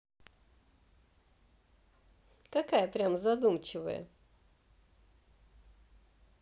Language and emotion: Russian, positive